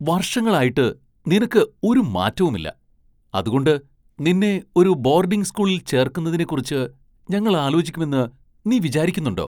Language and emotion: Malayalam, surprised